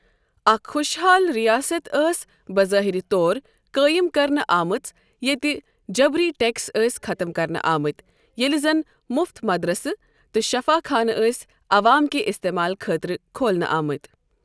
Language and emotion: Kashmiri, neutral